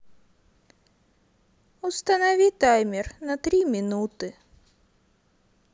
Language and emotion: Russian, sad